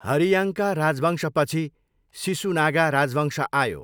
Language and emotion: Nepali, neutral